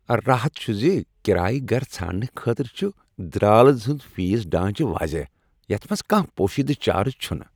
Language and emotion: Kashmiri, happy